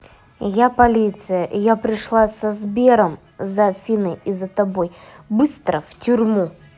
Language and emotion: Russian, neutral